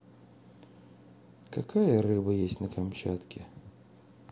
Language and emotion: Russian, neutral